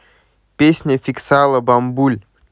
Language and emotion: Russian, neutral